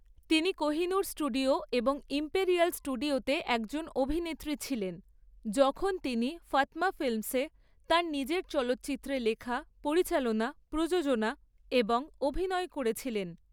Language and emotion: Bengali, neutral